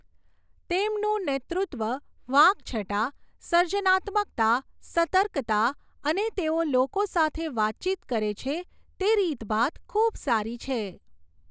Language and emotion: Gujarati, neutral